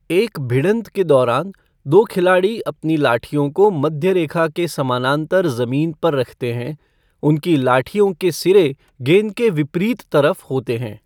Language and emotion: Hindi, neutral